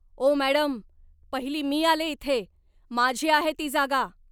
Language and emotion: Marathi, angry